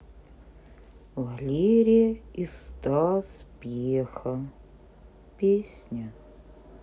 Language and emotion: Russian, sad